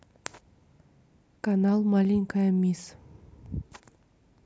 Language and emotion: Russian, neutral